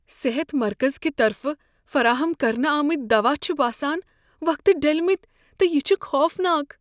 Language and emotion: Kashmiri, fearful